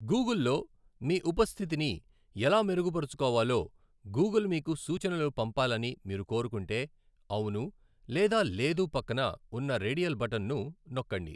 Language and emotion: Telugu, neutral